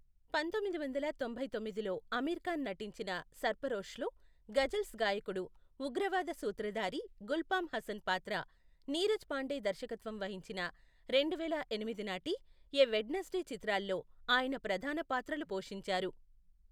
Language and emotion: Telugu, neutral